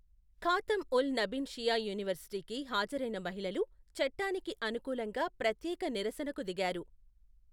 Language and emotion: Telugu, neutral